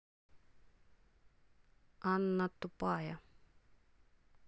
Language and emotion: Russian, neutral